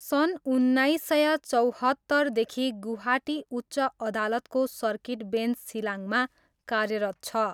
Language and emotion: Nepali, neutral